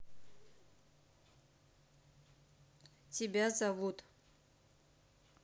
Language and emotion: Russian, neutral